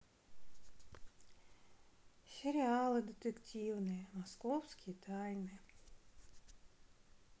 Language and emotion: Russian, sad